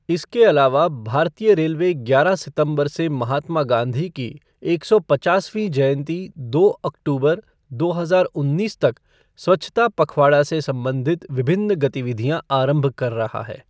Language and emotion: Hindi, neutral